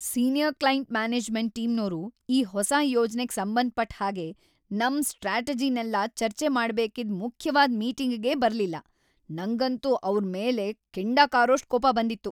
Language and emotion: Kannada, angry